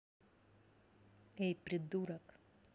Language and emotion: Russian, neutral